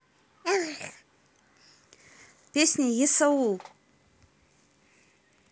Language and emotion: Russian, neutral